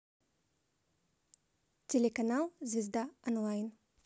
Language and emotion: Russian, positive